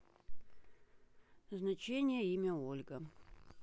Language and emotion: Russian, neutral